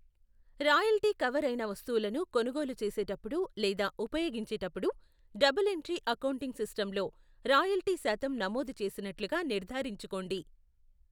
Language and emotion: Telugu, neutral